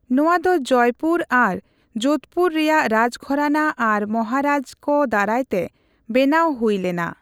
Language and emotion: Santali, neutral